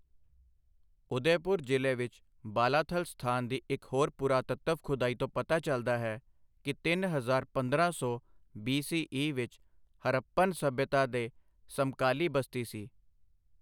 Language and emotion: Punjabi, neutral